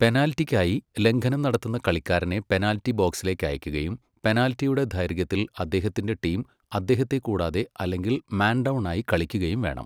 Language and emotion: Malayalam, neutral